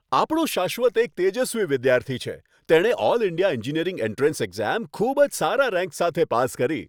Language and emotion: Gujarati, happy